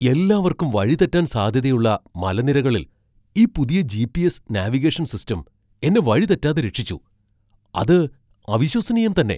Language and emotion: Malayalam, surprised